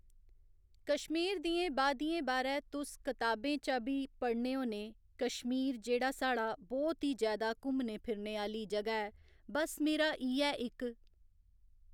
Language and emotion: Dogri, neutral